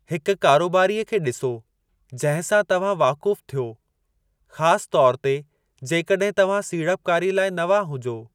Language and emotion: Sindhi, neutral